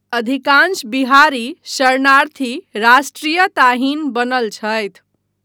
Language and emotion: Maithili, neutral